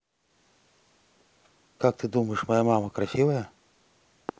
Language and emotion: Russian, neutral